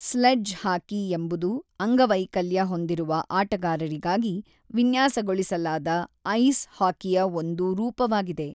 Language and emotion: Kannada, neutral